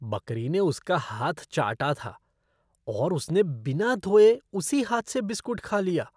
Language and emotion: Hindi, disgusted